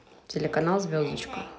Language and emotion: Russian, neutral